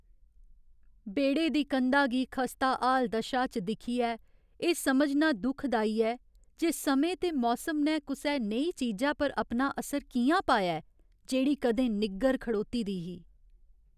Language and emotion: Dogri, sad